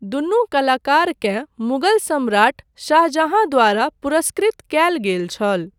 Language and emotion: Maithili, neutral